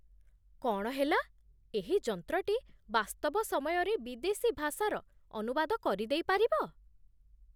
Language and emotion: Odia, surprised